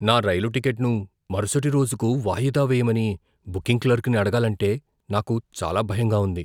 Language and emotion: Telugu, fearful